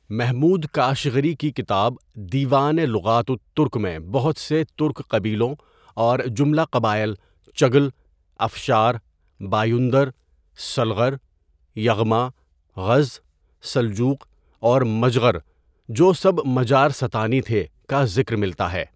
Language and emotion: Urdu, neutral